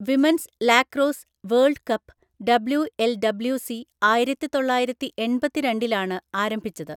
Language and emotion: Malayalam, neutral